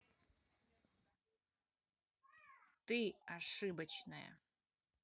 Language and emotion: Russian, angry